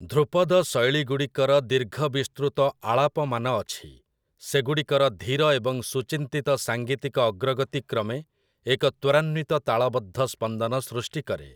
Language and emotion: Odia, neutral